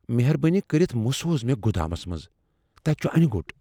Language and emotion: Kashmiri, fearful